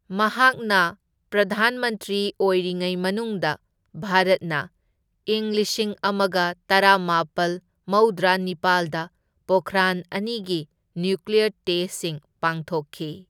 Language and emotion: Manipuri, neutral